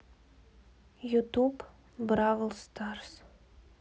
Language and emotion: Russian, sad